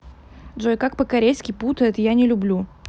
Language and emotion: Russian, neutral